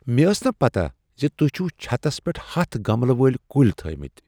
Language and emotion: Kashmiri, surprised